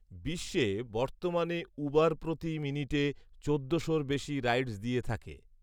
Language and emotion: Bengali, neutral